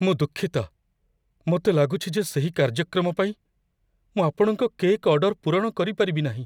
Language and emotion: Odia, fearful